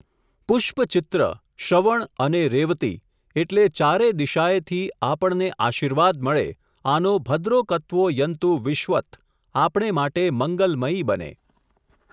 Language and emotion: Gujarati, neutral